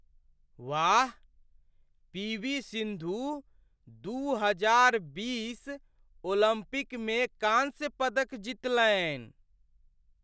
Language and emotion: Maithili, surprised